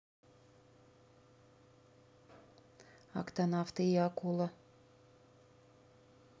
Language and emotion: Russian, neutral